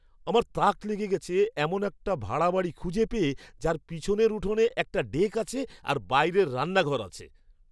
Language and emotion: Bengali, surprised